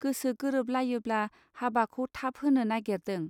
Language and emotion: Bodo, neutral